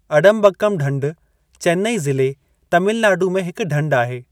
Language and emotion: Sindhi, neutral